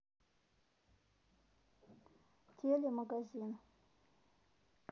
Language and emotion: Russian, neutral